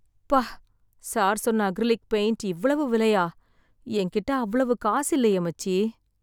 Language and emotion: Tamil, sad